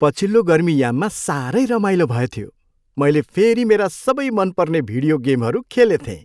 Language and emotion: Nepali, happy